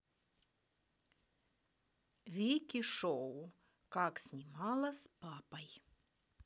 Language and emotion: Russian, neutral